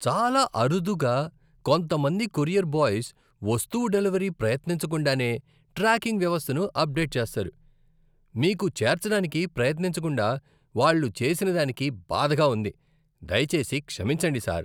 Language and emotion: Telugu, disgusted